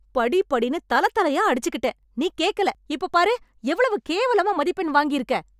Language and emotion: Tamil, angry